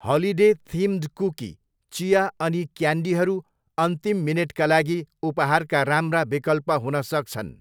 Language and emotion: Nepali, neutral